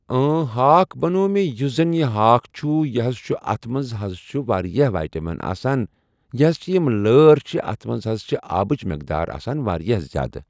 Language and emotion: Kashmiri, neutral